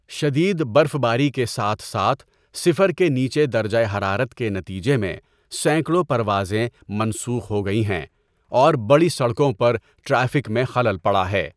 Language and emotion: Urdu, neutral